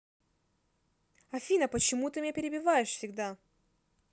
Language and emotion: Russian, angry